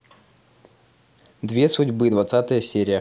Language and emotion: Russian, neutral